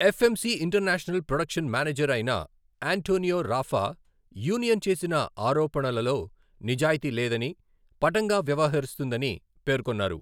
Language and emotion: Telugu, neutral